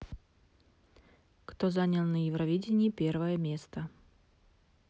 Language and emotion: Russian, neutral